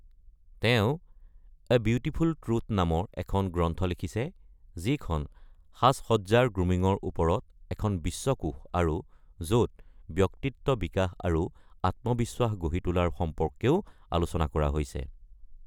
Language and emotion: Assamese, neutral